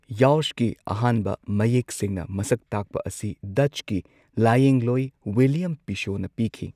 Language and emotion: Manipuri, neutral